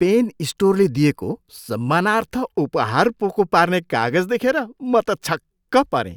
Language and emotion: Nepali, surprised